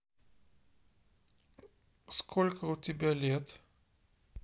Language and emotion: Russian, neutral